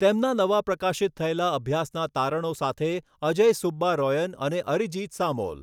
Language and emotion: Gujarati, neutral